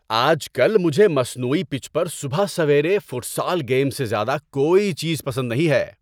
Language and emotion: Urdu, happy